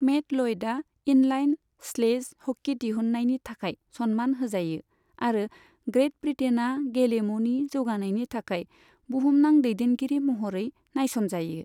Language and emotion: Bodo, neutral